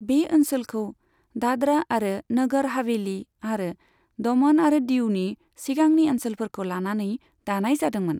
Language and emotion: Bodo, neutral